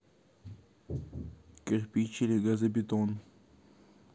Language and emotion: Russian, neutral